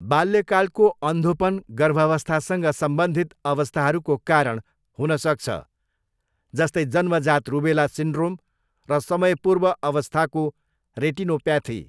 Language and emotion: Nepali, neutral